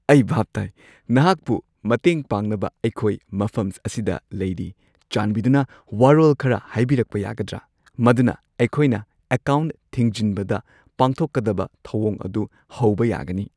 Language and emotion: Manipuri, happy